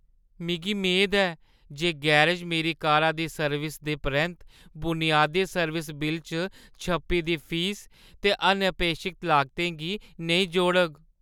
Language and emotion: Dogri, fearful